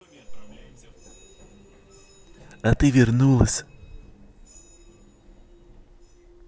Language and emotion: Russian, positive